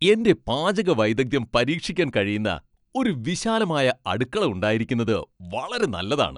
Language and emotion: Malayalam, happy